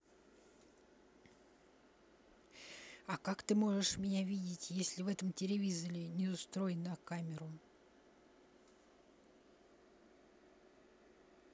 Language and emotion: Russian, neutral